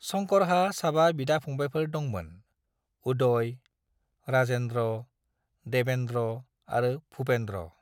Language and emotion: Bodo, neutral